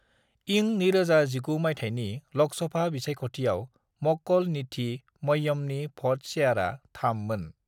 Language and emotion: Bodo, neutral